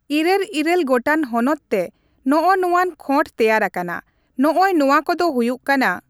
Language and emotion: Santali, neutral